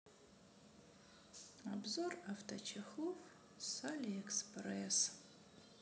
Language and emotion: Russian, sad